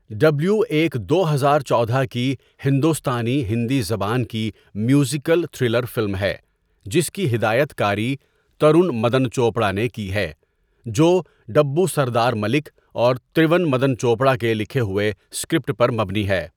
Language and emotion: Urdu, neutral